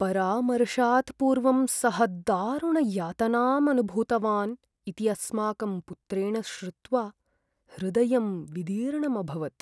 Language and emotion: Sanskrit, sad